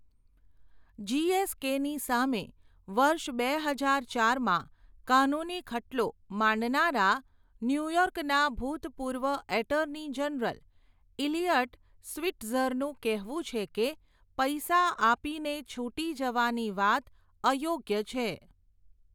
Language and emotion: Gujarati, neutral